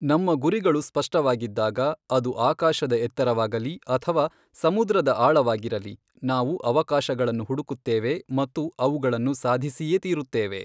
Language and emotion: Kannada, neutral